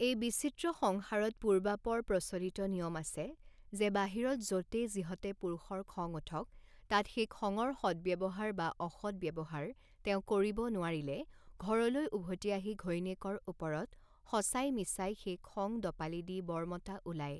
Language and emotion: Assamese, neutral